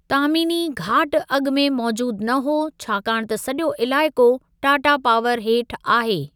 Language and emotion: Sindhi, neutral